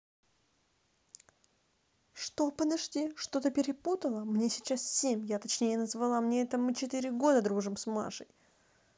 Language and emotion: Russian, angry